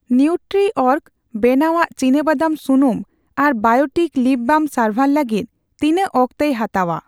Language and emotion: Santali, neutral